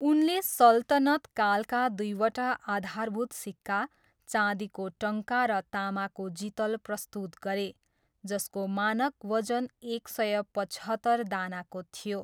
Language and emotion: Nepali, neutral